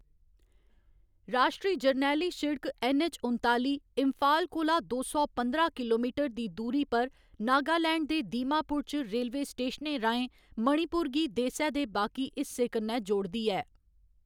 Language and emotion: Dogri, neutral